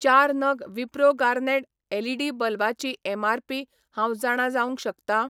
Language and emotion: Goan Konkani, neutral